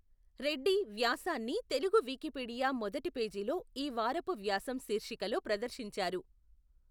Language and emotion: Telugu, neutral